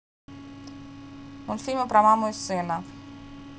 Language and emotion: Russian, neutral